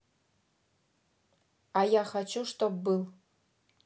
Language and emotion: Russian, neutral